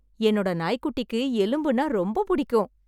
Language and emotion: Tamil, happy